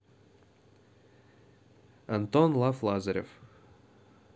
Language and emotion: Russian, neutral